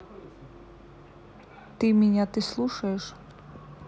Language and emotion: Russian, neutral